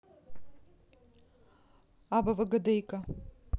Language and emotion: Russian, neutral